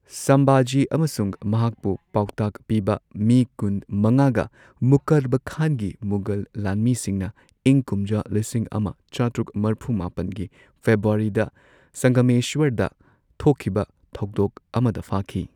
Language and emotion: Manipuri, neutral